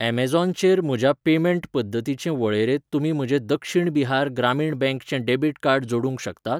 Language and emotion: Goan Konkani, neutral